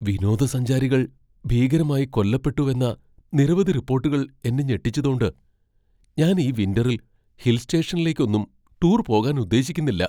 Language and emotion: Malayalam, fearful